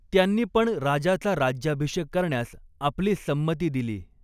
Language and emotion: Marathi, neutral